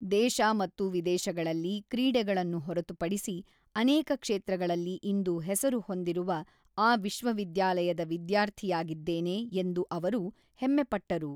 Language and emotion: Kannada, neutral